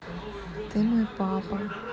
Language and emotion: Russian, neutral